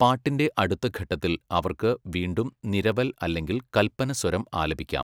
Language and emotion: Malayalam, neutral